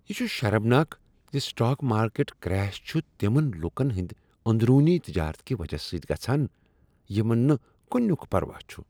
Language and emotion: Kashmiri, disgusted